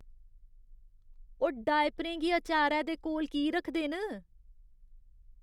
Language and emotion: Dogri, disgusted